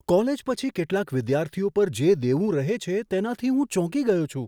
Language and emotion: Gujarati, surprised